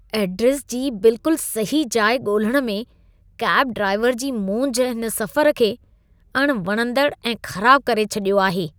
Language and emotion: Sindhi, disgusted